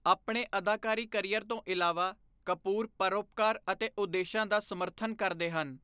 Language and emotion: Punjabi, neutral